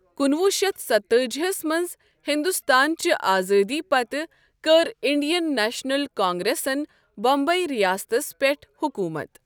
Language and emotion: Kashmiri, neutral